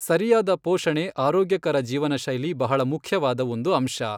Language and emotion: Kannada, neutral